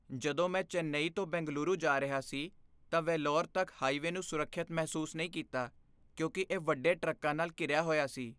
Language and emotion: Punjabi, fearful